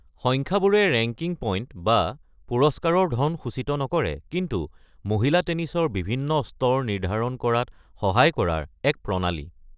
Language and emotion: Assamese, neutral